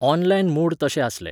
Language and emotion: Goan Konkani, neutral